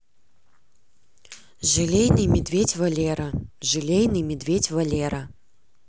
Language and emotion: Russian, neutral